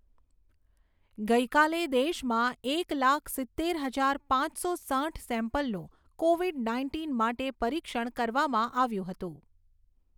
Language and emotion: Gujarati, neutral